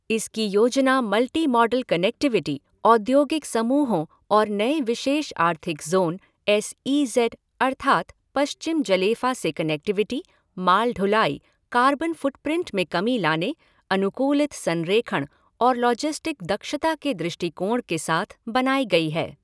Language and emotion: Hindi, neutral